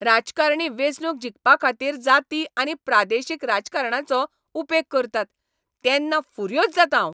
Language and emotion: Goan Konkani, angry